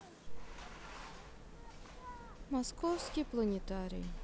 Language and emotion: Russian, sad